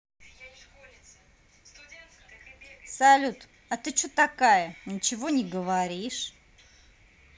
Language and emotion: Russian, angry